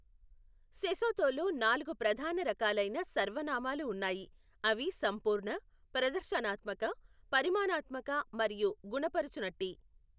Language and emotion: Telugu, neutral